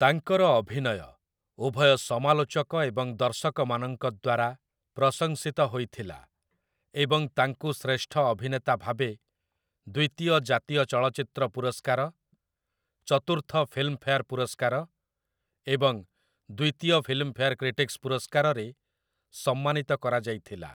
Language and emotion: Odia, neutral